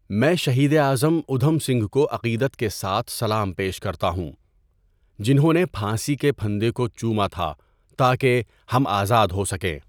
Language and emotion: Urdu, neutral